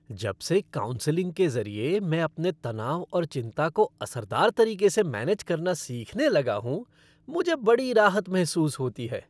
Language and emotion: Hindi, happy